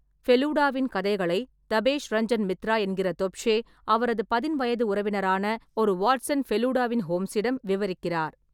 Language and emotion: Tamil, neutral